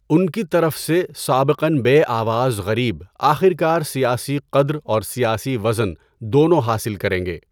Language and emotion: Urdu, neutral